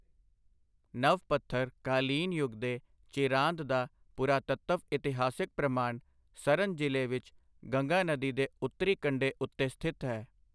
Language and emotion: Punjabi, neutral